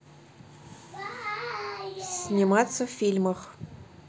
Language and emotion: Russian, neutral